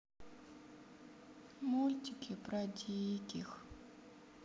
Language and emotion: Russian, sad